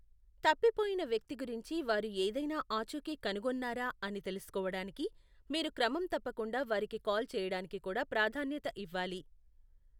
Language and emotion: Telugu, neutral